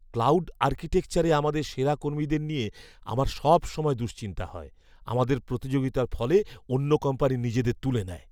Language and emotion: Bengali, fearful